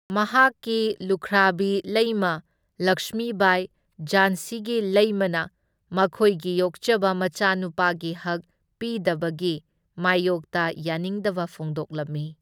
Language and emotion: Manipuri, neutral